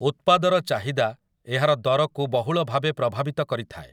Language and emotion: Odia, neutral